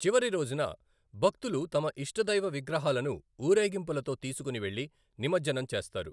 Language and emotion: Telugu, neutral